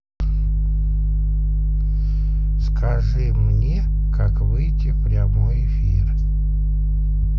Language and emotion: Russian, neutral